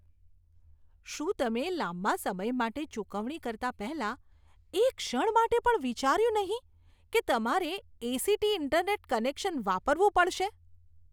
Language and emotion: Gujarati, disgusted